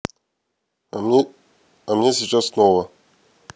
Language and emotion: Russian, neutral